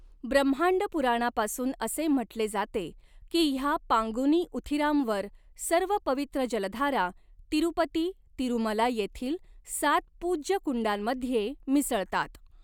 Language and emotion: Marathi, neutral